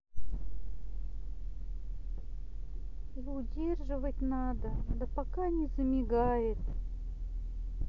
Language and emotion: Russian, sad